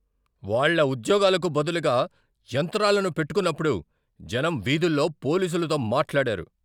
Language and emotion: Telugu, angry